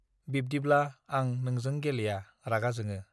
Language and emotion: Bodo, neutral